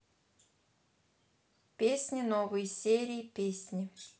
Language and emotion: Russian, neutral